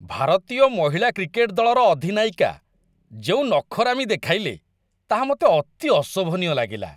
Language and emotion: Odia, disgusted